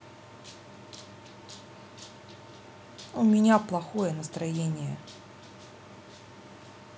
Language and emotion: Russian, sad